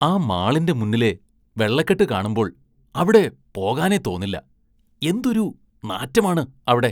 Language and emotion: Malayalam, disgusted